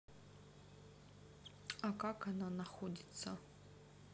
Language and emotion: Russian, neutral